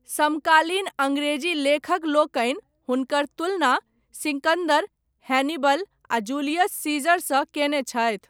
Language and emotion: Maithili, neutral